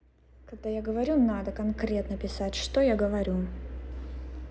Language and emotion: Russian, angry